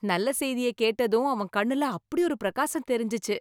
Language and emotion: Tamil, happy